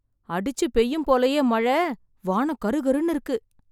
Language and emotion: Tamil, surprised